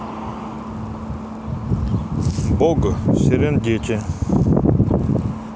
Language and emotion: Russian, neutral